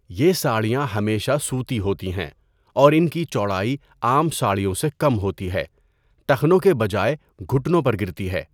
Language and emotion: Urdu, neutral